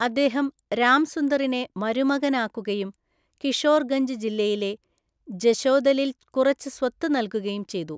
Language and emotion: Malayalam, neutral